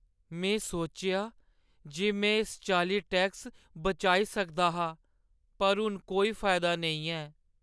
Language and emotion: Dogri, sad